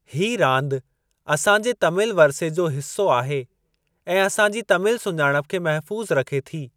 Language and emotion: Sindhi, neutral